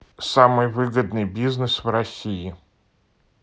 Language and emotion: Russian, neutral